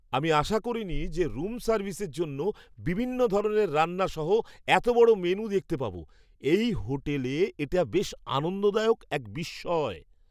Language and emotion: Bengali, surprised